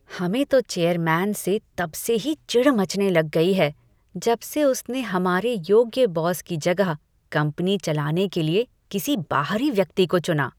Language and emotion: Hindi, disgusted